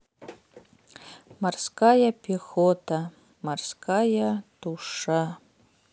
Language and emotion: Russian, sad